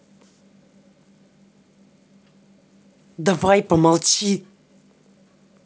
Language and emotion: Russian, angry